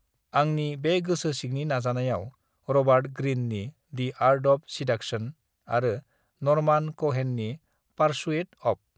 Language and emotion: Bodo, neutral